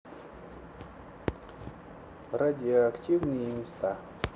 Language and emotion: Russian, neutral